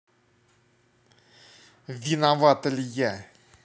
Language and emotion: Russian, angry